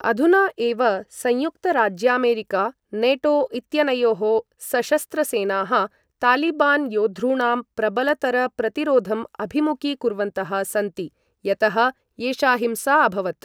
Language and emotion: Sanskrit, neutral